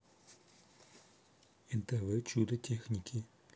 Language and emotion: Russian, neutral